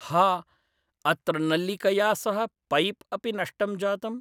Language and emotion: Sanskrit, neutral